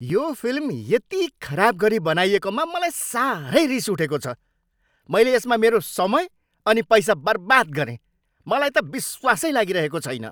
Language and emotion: Nepali, angry